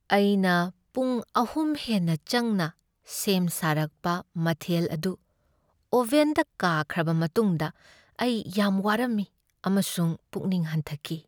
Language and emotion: Manipuri, sad